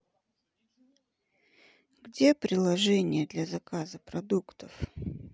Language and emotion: Russian, sad